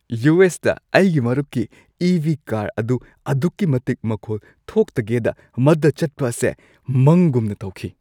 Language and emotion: Manipuri, happy